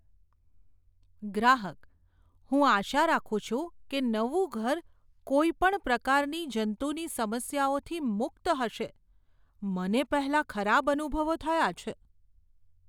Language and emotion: Gujarati, fearful